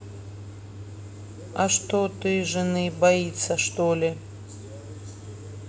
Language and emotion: Russian, neutral